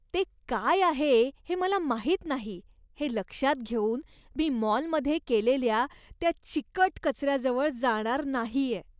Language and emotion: Marathi, disgusted